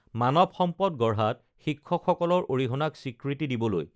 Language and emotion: Assamese, neutral